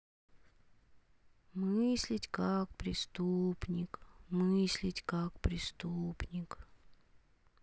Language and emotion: Russian, sad